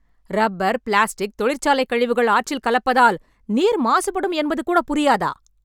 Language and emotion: Tamil, angry